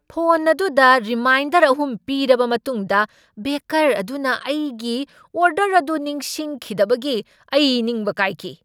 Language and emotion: Manipuri, angry